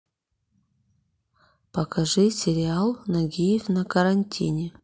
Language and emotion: Russian, neutral